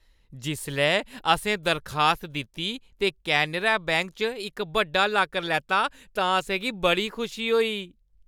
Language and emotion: Dogri, happy